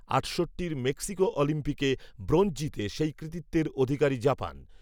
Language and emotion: Bengali, neutral